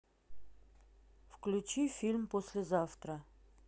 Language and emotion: Russian, neutral